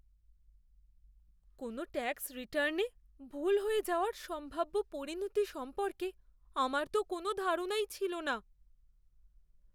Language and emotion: Bengali, fearful